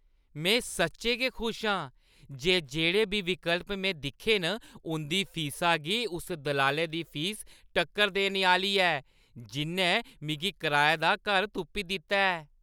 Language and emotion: Dogri, happy